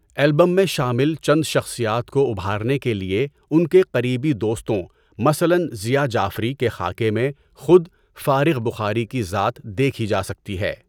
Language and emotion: Urdu, neutral